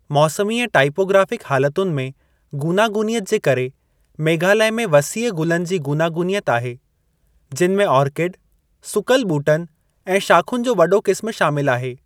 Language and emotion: Sindhi, neutral